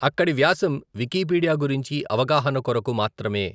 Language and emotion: Telugu, neutral